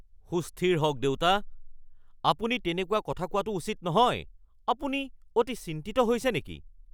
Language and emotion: Assamese, angry